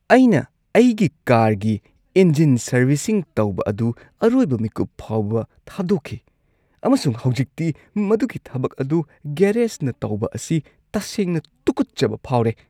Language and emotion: Manipuri, disgusted